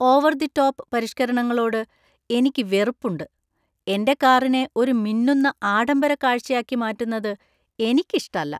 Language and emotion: Malayalam, disgusted